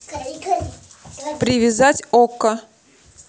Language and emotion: Russian, neutral